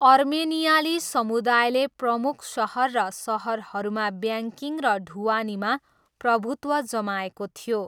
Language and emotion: Nepali, neutral